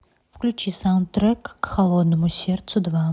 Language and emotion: Russian, neutral